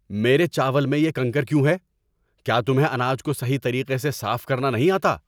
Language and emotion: Urdu, angry